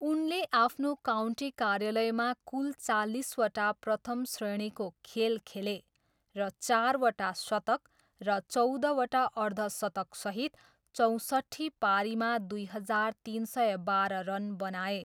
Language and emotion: Nepali, neutral